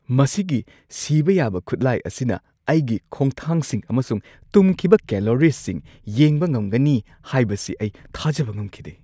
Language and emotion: Manipuri, surprised